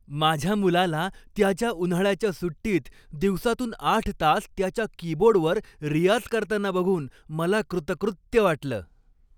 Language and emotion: Marathi, happy